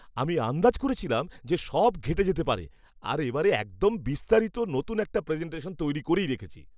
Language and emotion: Bengali, happy